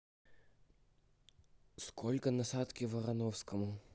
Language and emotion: Russian, neutral